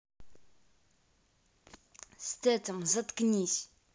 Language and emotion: Russian, angry